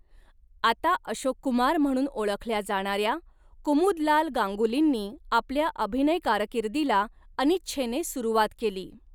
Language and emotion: Marathi, neutral